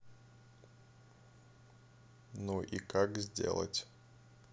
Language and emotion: Russian, neutral